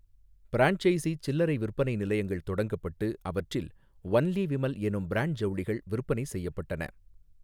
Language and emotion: Tamil, neutral